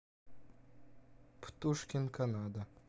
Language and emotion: Russian, neutral